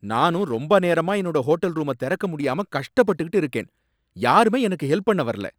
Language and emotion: Tamil, angry